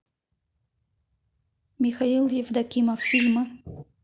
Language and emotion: Russian, neutral